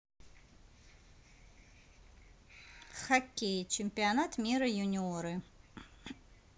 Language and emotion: Russian, neutral